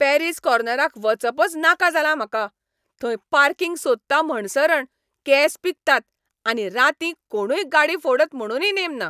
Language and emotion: Goan Konkani, angry